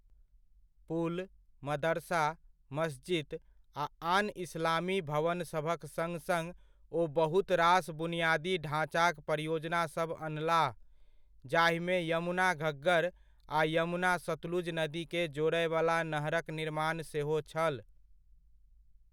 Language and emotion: Maithili, neutral